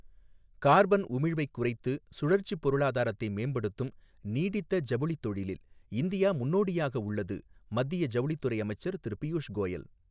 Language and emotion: Tamil, neutral